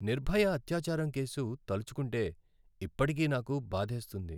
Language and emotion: Telugu, sad